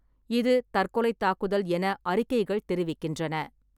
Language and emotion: Tamil, neutral